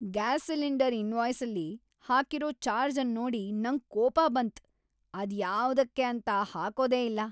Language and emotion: Kannada, angry